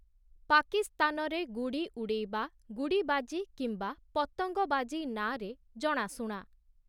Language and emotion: Odia, neutral